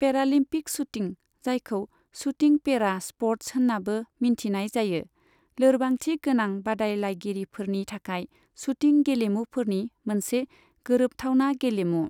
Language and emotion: Bodo, neutral